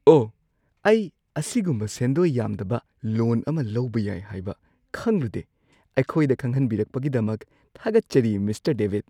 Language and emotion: Manipuri, surprised